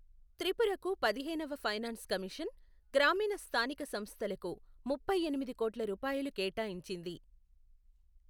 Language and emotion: Telugu, neutral